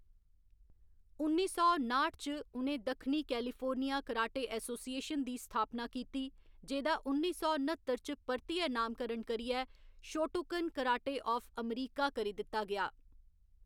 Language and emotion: Dogri, neutral